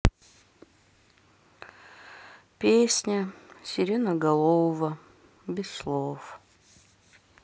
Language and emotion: Russian, sad